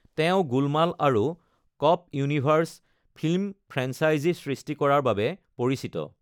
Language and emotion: Assamese, neutral